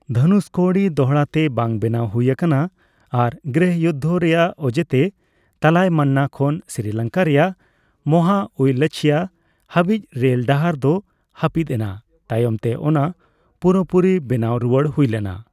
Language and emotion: Santali, neutral